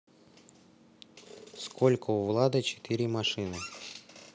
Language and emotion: Russian, neutral